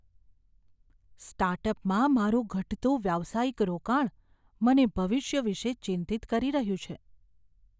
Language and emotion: Gujarati, fearful